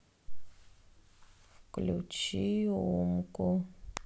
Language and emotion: Russian, sad